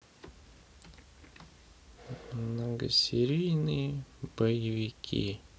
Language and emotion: Russian, sad